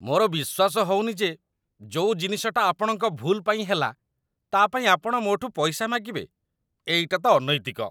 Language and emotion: Odia, disgusted